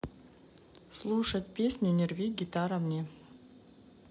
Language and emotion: Russian, neutral